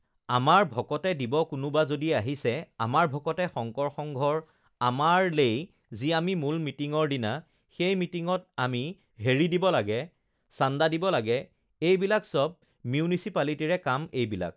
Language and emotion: Assamese, neutral